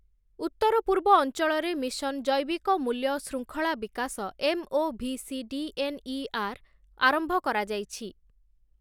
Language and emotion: Odia, neutral